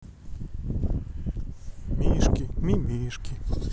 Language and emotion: Russian, sad